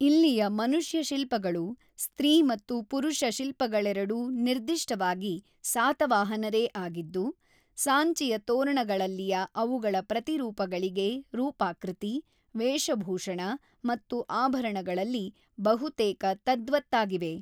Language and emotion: Kannada, neutral